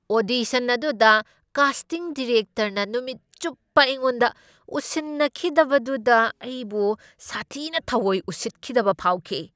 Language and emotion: Manipuri, angry